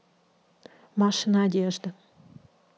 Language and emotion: Russian, neutral